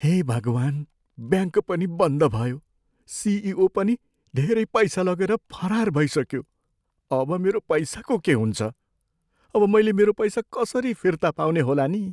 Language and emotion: Nepali, fearful